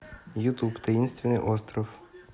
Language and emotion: Russian, neutral